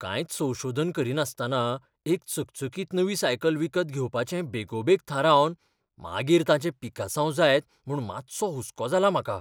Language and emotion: Goan Konkani, fearful